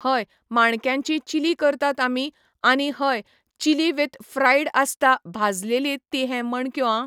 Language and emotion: Goan Konkani, neutral